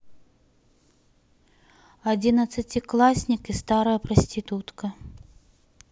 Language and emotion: Russian, neutral